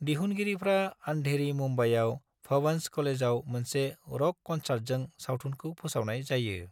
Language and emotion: Bodo, neutral